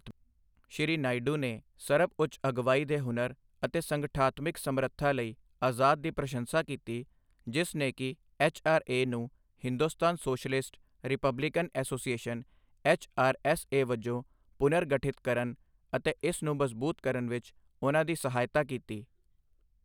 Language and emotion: Punjabi, neutral